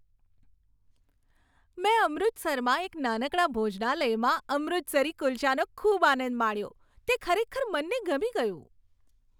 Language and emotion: Gujarati, happy